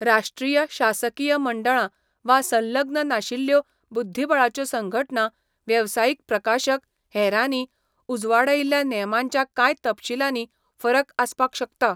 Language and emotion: Goan Konkani, neutral